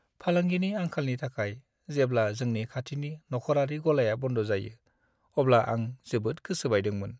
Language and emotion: Bodo, sad